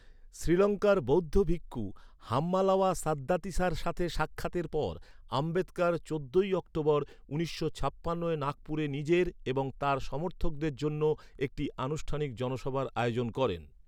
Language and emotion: Bengali, neutral